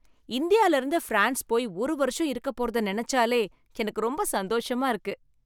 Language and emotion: Tamil, happy